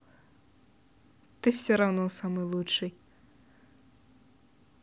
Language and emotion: Russian, positive